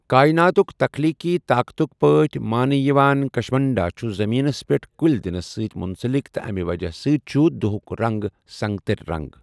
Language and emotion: Kashmiri, neutral